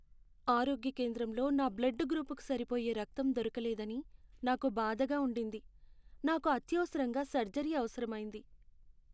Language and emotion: Telugu, sad